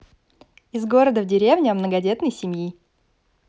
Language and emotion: Russian, positive